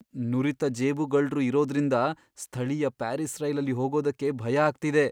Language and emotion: Kannada, fearful